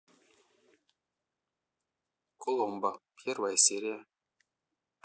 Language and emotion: Russian, neutral